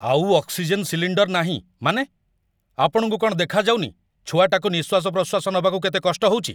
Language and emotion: Odia, angry